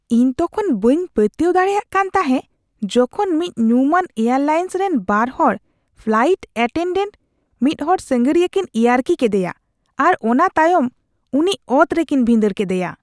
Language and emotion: Santali, disgusted